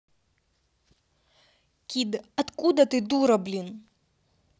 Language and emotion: Russian, angry